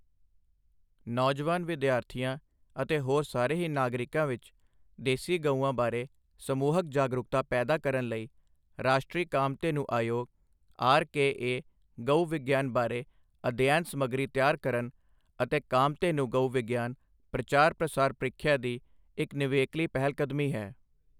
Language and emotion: Punjabi, neutral